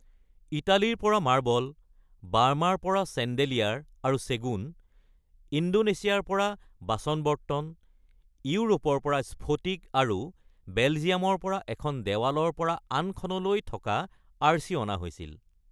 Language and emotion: Assamese, neutral